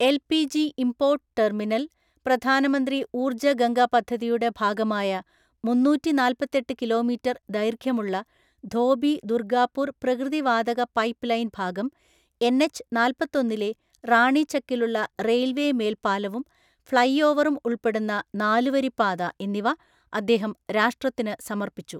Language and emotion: Malayalam, neutral